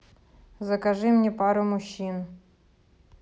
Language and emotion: Russian, neutral